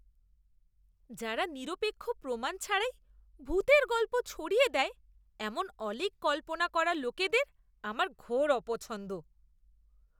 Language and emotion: Bengali, disgusted